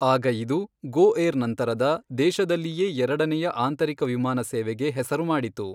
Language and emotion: Kannada, neutral